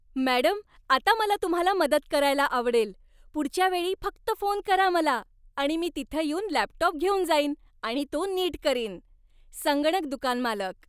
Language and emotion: Marathi, happy